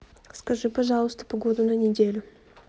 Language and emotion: Russian, neutral